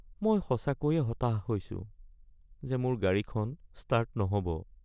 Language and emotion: Assamese, sad